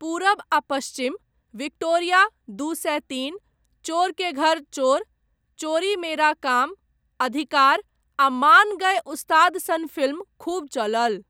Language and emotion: Maithili, neutral